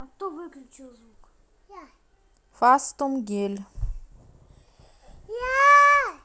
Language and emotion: Russian, neutral